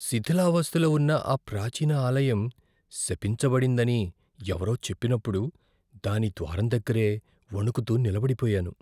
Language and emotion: Telugu, fearful